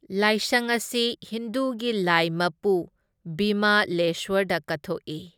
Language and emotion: Manipuri, neutral